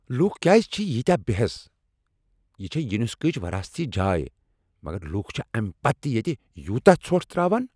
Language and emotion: Kashmiri, angry